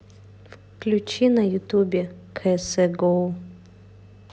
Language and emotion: Russian, neutral